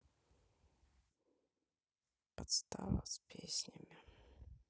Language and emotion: Russian, sad